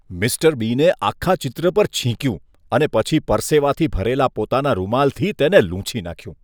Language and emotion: Gujarati, disgusted